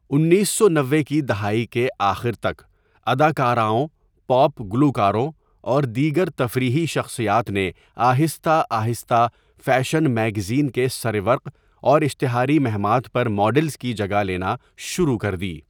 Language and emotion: Urdu, neutral